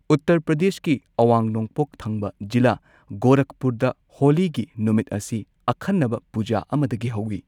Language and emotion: Manipuri, neutral